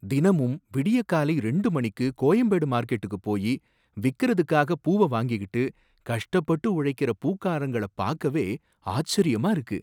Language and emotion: Tamil, surprised